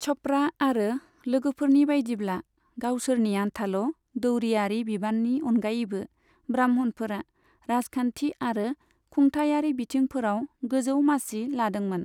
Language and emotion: Bodo, neutral